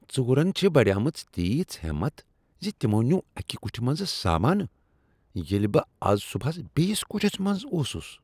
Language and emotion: Kashmiri, disgusted